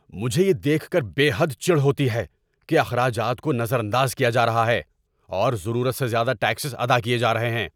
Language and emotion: Urdu, angry